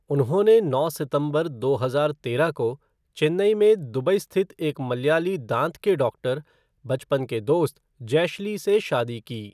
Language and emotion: Hindi, neutral